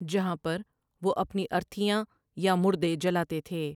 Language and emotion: Urdu, neutral